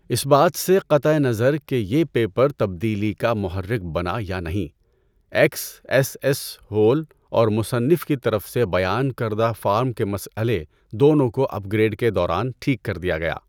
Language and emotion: Urdu, neutral